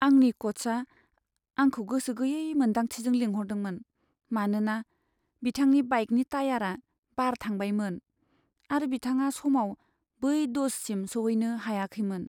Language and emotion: Bodo, sad